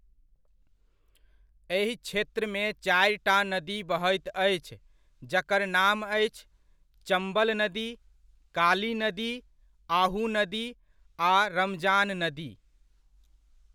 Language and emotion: Maithili, neutral